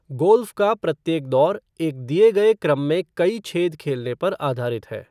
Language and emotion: Hindi, neutral